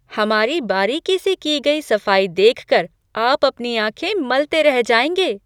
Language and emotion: Hindi, surprised